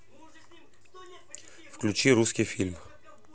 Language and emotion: Russian, neutral